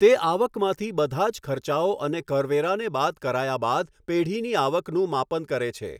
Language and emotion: Gujarati, neutral